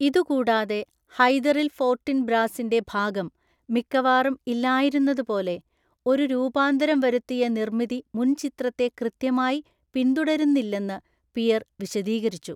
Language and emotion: Malayalam, neutral